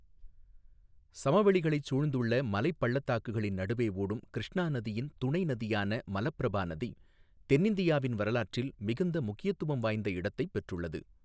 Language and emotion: Tamil, neutral